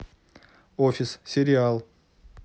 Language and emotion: Russian, neutral